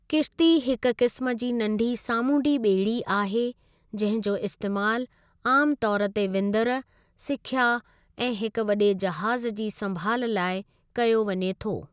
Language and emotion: Sindhi, neutral